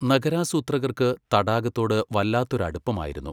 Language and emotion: Malayalam, neutral